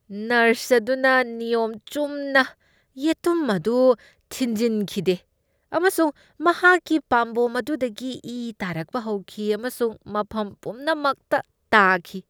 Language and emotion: Manipuri, disgusted